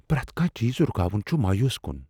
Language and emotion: Kashmiri, fearful